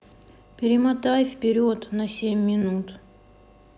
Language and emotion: Russian, neutral